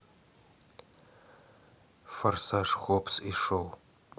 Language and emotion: Russian, neutral